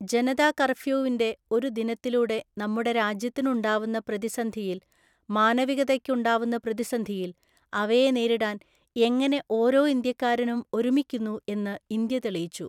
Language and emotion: Malayalam, neutral